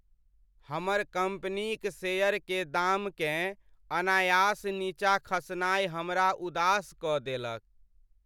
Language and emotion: Maithili, sad